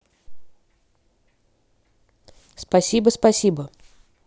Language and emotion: Russian, neutral